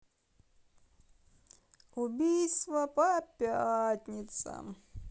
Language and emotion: Russian, sad